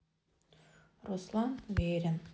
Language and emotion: Russian, sad